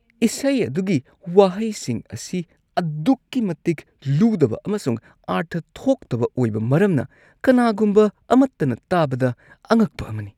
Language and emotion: Manipuri, disgusted